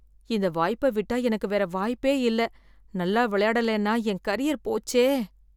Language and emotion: Tamil, fearful